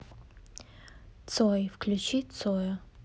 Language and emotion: Russian, neutral